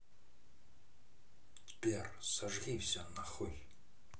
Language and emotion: Russian, angry